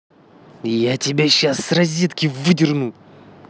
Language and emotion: Russian, angry